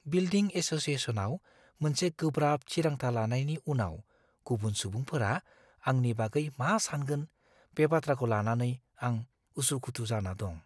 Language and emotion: Bodo, fearful